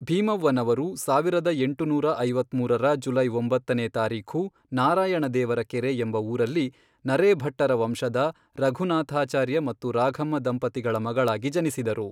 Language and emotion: Kannada, neutral